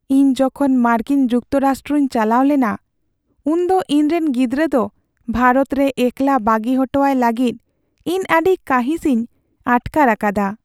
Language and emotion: Santali, sad